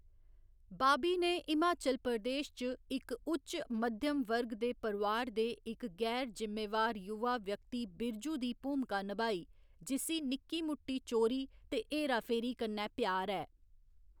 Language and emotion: Dogri, neutral